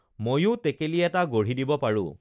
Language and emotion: Assamese, neutral